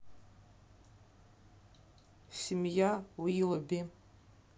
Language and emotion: Russian, neutral